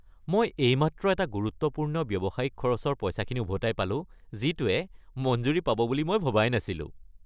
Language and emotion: Assamese, happy